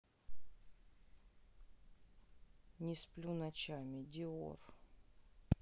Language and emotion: Russian, sad